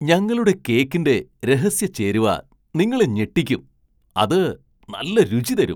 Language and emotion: Malayalam, surprised